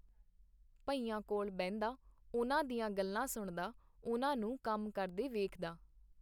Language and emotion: Punjabi, neutral